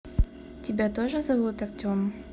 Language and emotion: Russian, neutral